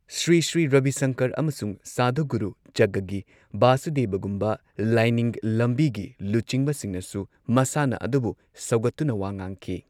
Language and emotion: Manipuri, neutral